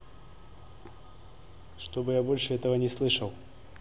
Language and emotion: Russian, angry